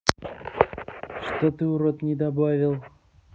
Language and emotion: Russian, angry